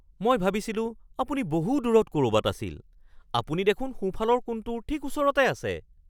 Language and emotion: Assamese, surprised